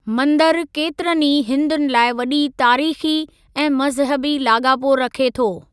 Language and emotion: Sindhi, neutral